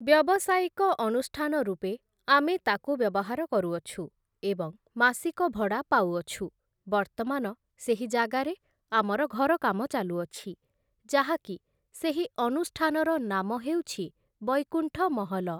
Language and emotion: Odia, neutral